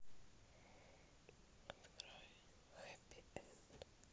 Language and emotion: Russian, neutral